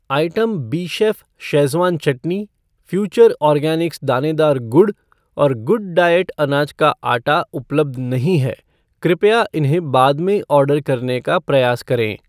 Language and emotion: Hindi, neutral